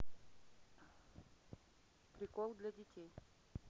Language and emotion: Russian, neutral